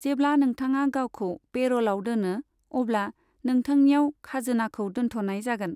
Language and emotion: Bodo, neutral